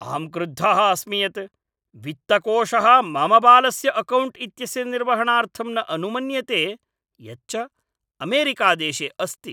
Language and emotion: Sanskrit, angry